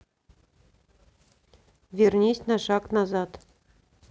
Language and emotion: Russian, neutral